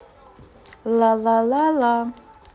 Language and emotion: Russian, positive